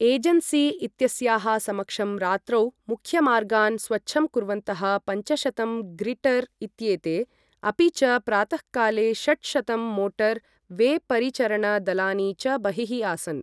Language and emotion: Sanskrit, neutral